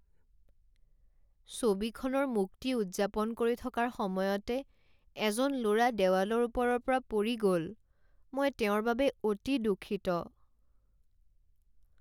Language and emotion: Assamese, sad